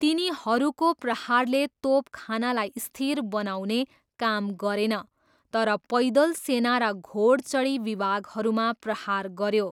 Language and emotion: Nepali, neutral